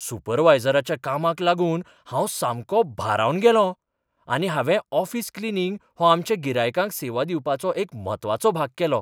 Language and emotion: Goan Konkani, surprised